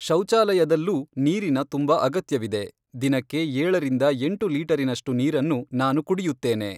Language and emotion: Kannada, neutral